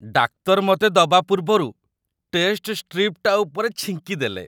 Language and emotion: Odia, disgusted